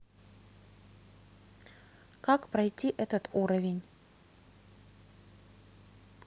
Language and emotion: Russian, neutral